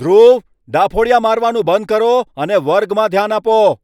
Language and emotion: Gujarati, angry